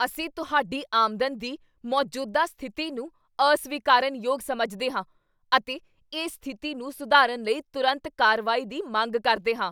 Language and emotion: Punjabi, angry